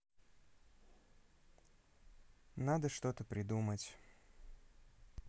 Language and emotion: Russian, sad